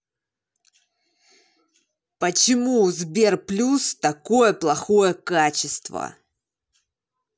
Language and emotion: Russian, angry